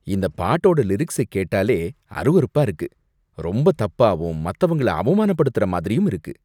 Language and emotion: Tamil, disgusted